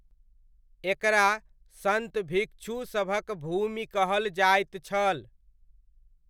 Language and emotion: Maithili, neutral